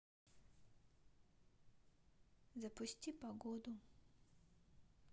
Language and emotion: Russian, neutral